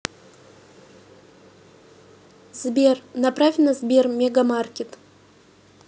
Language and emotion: Russian, neutral